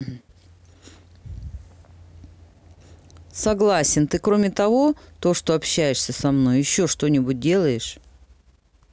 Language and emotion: Russian, neutral